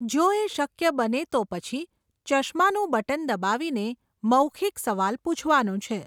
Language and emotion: Gujarati, neutral